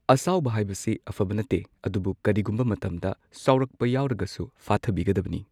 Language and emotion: Manipuri, neutral